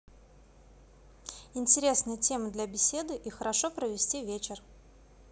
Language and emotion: Russian, positive